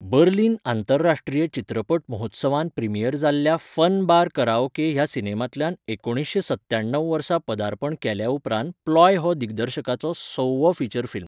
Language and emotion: Goan Konkani, neutral